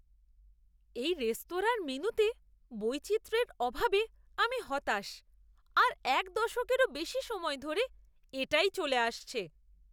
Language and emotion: Bengali, disgusted